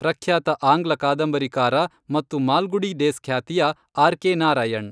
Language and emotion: Kannada, neutral